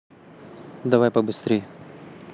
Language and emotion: Russian, neutral